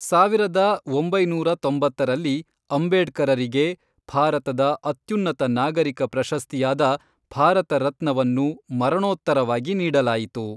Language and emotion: Kannada, neutral